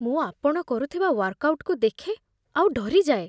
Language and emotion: Odia, fearful